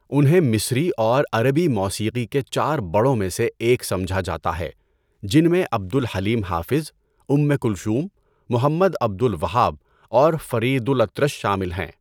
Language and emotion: Urdu, neutral